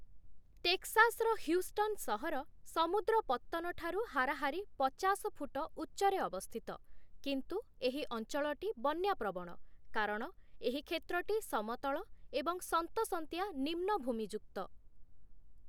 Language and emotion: Odia, neutral